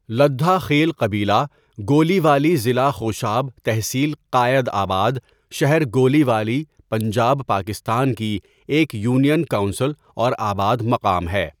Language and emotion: Urdu, neutral